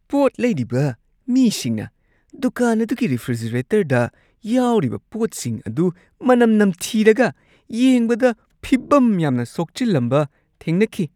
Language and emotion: Manipuri, disgusted